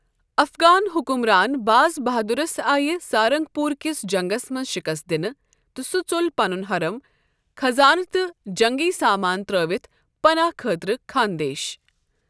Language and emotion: Kashmiri, neutral